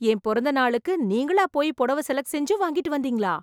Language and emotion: Tamil, surprised